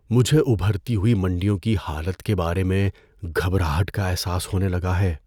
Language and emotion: Urdu, fearful